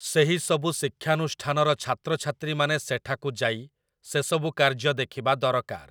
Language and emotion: Odia, neutral